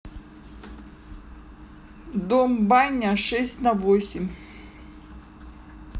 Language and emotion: Russian, neutral